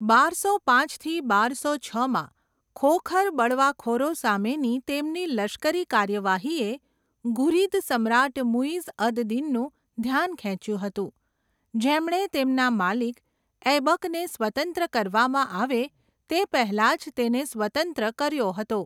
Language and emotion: Gujarati, neutral